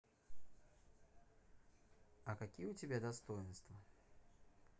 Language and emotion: Russian, neutral